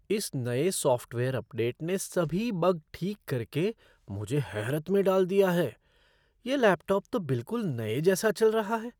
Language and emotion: Hindi, surprised